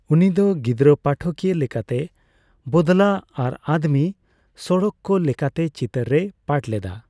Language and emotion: Santali, neutral